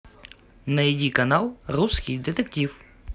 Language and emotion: Russian, positive